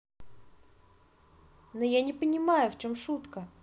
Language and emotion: Russian, neutral